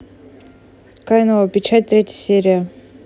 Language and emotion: Russian, neutral